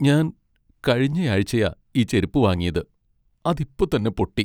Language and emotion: Malayalam, sad